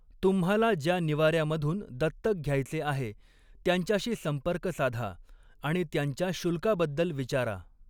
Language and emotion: Marathi, neutral